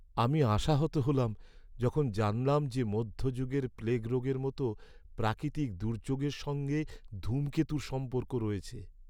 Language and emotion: Bengali, sad